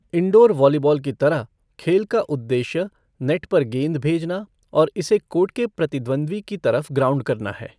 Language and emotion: Hindi, neutral